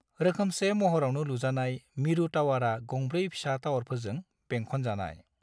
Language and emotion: Bodo, neutral